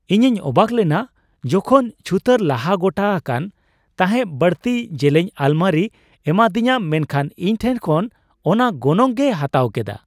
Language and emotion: Santali, surprised